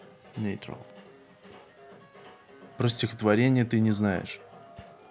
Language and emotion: Russian, neutral